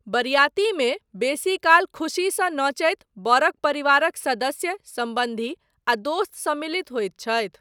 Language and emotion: Maithili, neutral